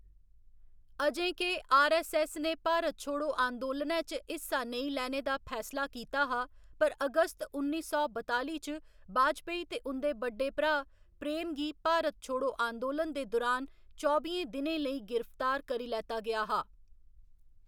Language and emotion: Dogri, neutral